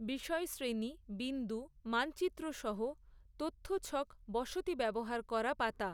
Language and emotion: Bengali, neutral